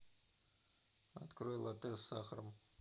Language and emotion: Russian, neutral